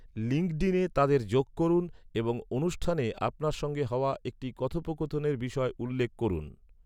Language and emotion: Bengali, neutral